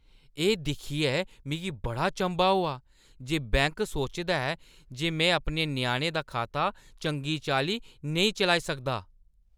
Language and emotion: Dogri, disgusted